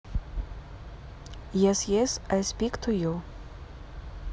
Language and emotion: Russian, neutral